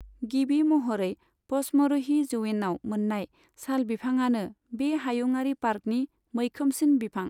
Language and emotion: Bodo, neutral